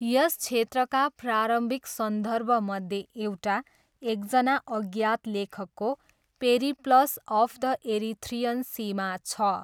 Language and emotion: Nepali, neutral